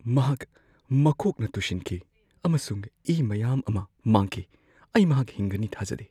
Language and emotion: Manipuri, fearful